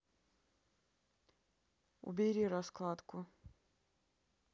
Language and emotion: Russian, neutral